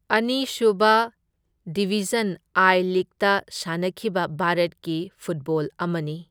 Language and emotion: Manipuri, neutral